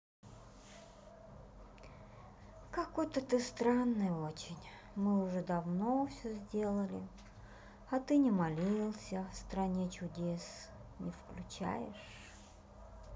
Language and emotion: Russian, sad